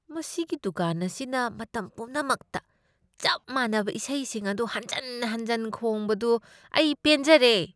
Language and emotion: Manipuri, disgusted